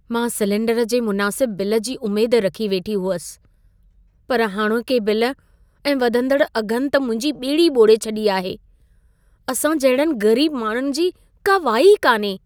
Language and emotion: Sindhi, sad